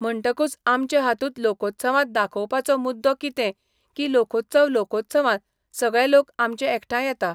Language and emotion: Goan Konkani, neutral